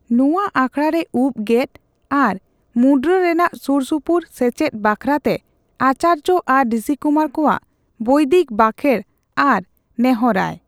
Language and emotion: Santali, neutral